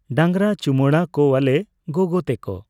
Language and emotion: Santali, neutral